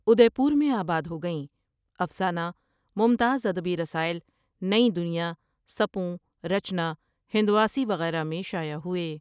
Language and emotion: Urdu, neutral